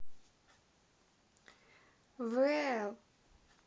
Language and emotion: Russian, positive